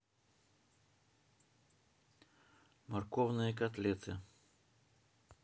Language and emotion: Russian, neutral